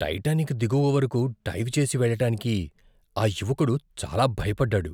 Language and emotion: Telugu, fearful